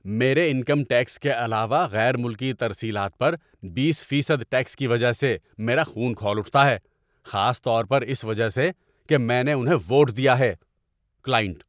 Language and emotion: Urdu, angry